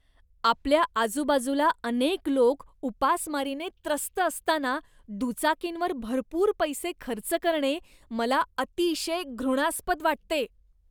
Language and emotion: Marathi, disgusted